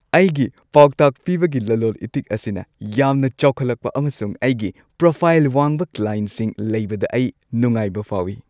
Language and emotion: Manipuri, happy